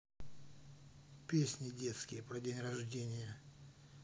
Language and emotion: Russian, neutral